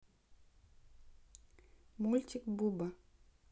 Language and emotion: Russian, neutral